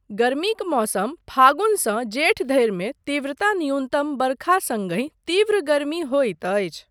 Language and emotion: Maithili, neutral